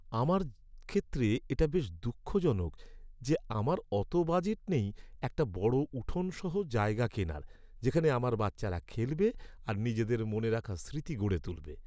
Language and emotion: Bengali, sad